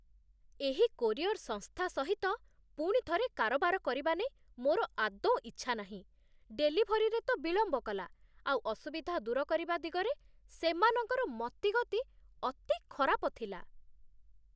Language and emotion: Odia, disgusted